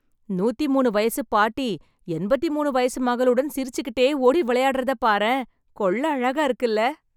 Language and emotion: Tamil, happy